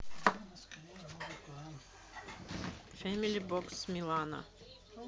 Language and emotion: Russian, neutral